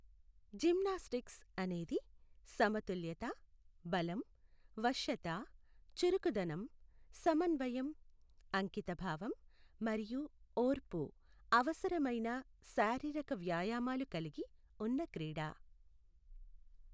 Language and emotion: Telugu, neutral